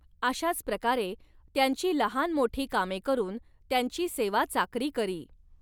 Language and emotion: Marathi, neutral